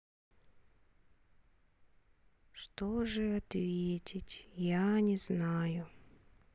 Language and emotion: Russian, sad